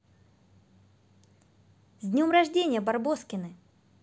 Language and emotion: Russian, positive